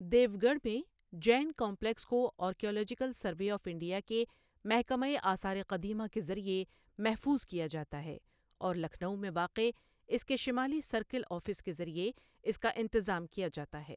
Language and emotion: Urdu, neutral